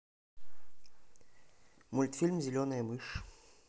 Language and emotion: Russian, neutral